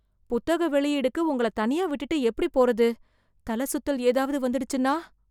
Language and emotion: Tamil, fearful